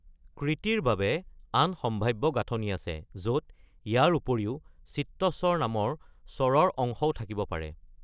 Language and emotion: Assamese, neutral